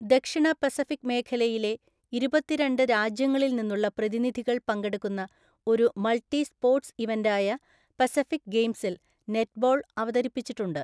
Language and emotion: Malayalam, neutral